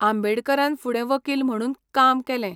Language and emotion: Goan Konkani, neutral